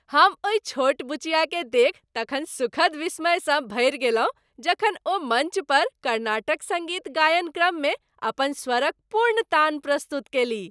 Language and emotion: Maithili, happy